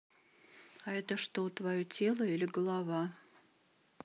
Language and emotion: Russian, neutral